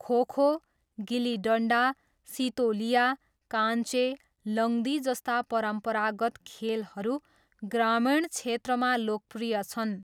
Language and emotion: Nepali, neutral